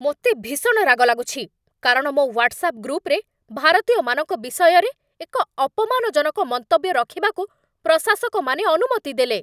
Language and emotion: Odia, angry